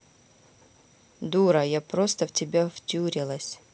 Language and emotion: Russian, neutral